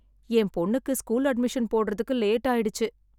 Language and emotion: Tamil, sad